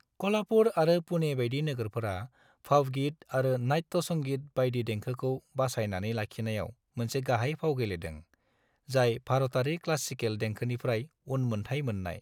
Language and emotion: Bodo, neutral